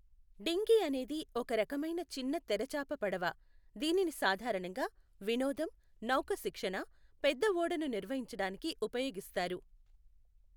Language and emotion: Telugu, neutral